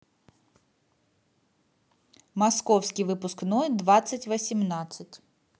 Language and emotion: Russian, neutral